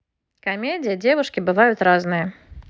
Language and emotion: Russian, positive